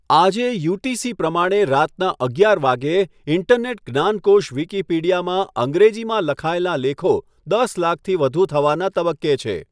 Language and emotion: Gujarati, neutral